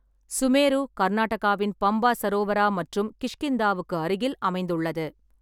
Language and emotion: Tamil, neutral